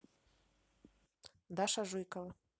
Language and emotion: Russian, neutral